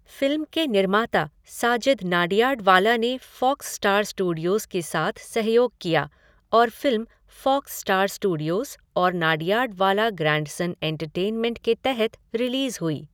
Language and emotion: Hindi, neutral